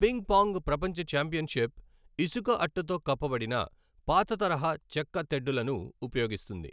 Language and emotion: Telugu, neutral